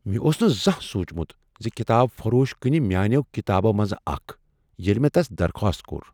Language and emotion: Kashmiri, surprised